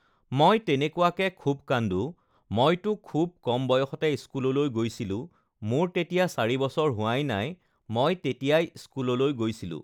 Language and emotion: Assamese, neutral